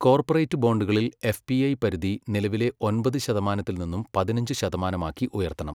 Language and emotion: Malayalam, neutral